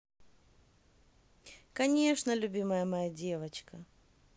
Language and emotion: Russian, positive